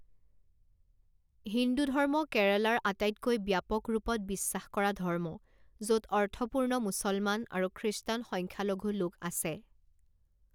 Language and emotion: Assamese, neutral